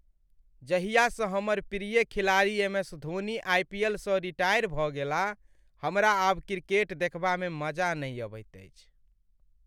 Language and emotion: Maithili, sad